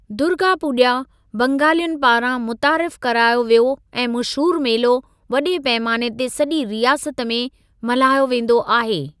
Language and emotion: Sindhi, neutral